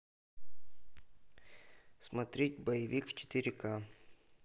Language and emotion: Russian, neutral